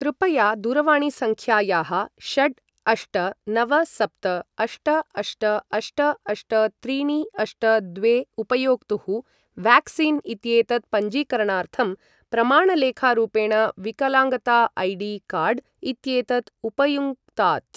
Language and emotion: Sanskrit, neutral